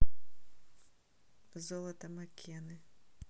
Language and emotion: Russian, neutral